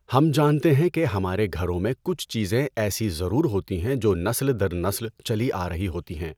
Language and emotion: Urdu, neutral